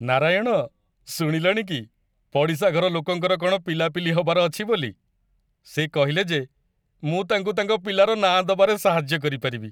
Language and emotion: Odia, happy